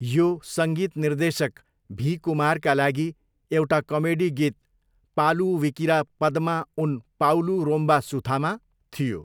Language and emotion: Nepali, neutral